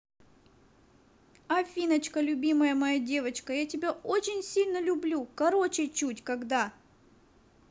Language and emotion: Russian, positive